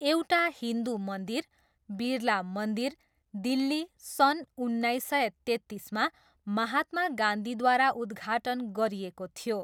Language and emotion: Nepali, neutral